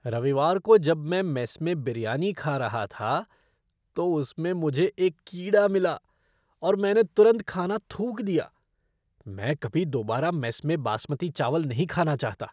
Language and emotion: Hindi, disgusted